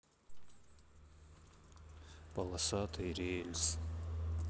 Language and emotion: Russian, sad